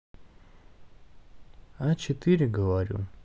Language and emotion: Russian, neutral